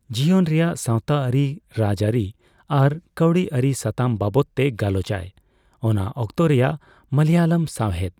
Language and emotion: Santali, neutral